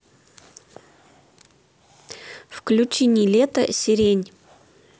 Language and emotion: Russian, neutral